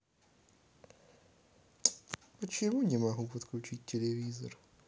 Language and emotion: Russian, sad